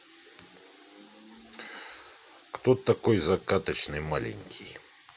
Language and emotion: Russian, neutral